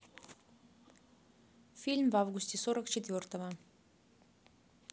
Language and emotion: Russian, neutral